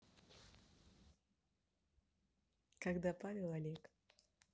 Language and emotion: Russian, neutral